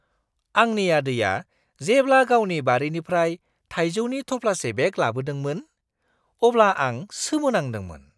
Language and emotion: Bodo, surprised